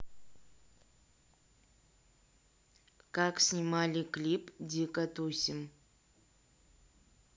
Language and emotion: Russian, neutral